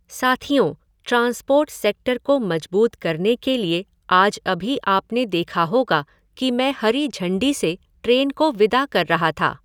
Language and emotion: Hindi, neutral